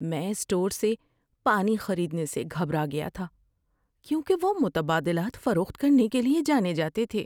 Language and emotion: Urdu, fearful